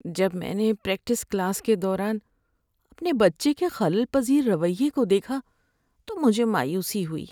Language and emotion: Urdu, sad